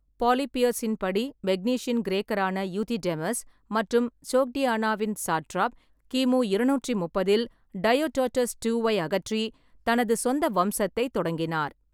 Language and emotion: Tamil, neutral